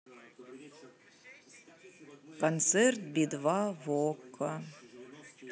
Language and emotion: Russian, sad